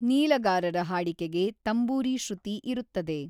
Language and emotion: Kannada, neutral